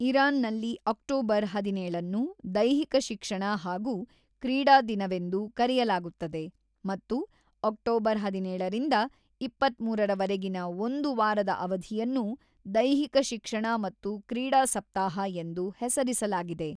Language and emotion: Kannada, neutral